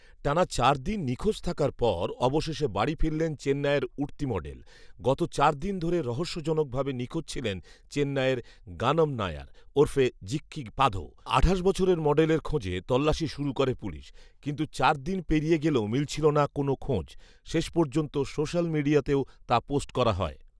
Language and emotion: Bengali, neutral